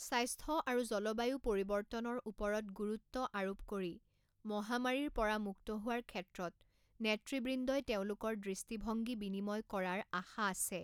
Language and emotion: Assamese, neutral